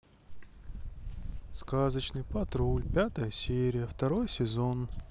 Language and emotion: Russian, sad